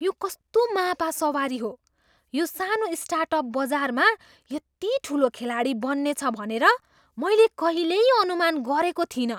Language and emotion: Nepali, surprised